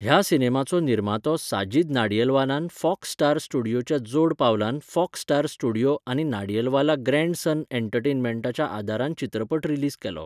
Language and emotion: Goan Konkani, neutral